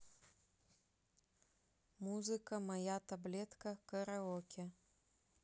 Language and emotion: Russian, neutral